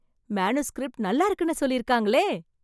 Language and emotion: Tamil, surprised